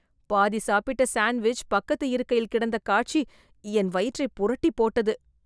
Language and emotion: Tamil, disgusted